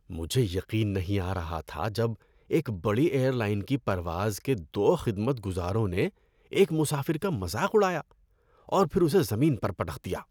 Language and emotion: Urdu, disgusted